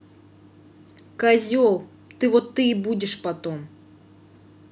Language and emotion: Russian, angry